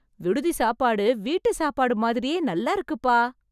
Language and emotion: Tamil, happy